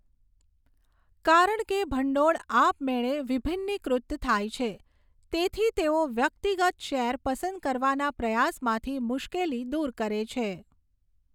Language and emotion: Gujarati, neutral